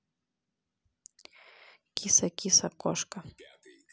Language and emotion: Russian, neutral